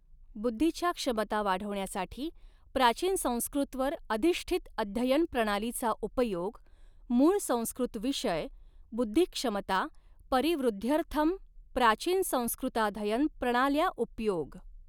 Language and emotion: Marathi, neutral